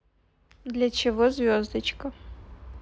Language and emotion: Russian, neutral